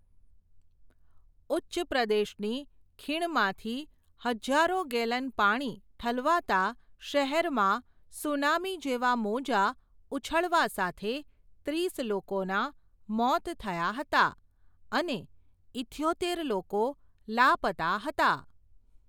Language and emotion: Gujarati, neutral